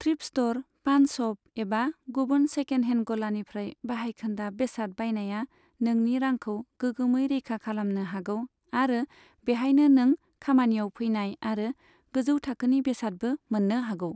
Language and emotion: Bodo, neutral